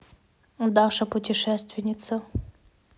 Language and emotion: Russian, neutral